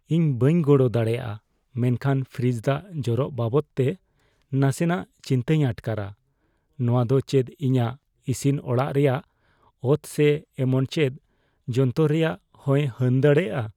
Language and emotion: Santali, fearful